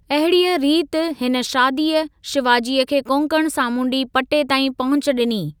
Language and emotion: Sindhi, neutral